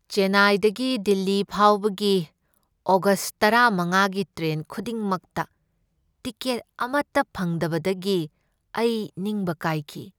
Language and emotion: Manipuri, sad